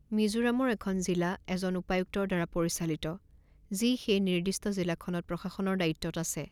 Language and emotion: Assamese, neutral